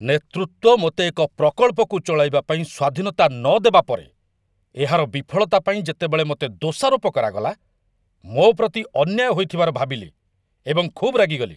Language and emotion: Odia, angry